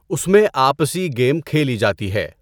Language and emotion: Urdu, neutral